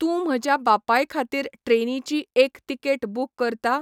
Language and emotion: Goan Konkani, neutral